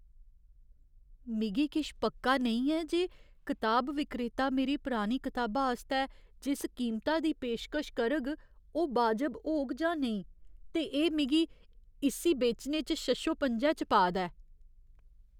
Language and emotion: Dogri, fearful